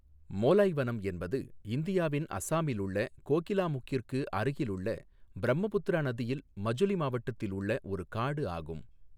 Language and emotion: Tamil, neutral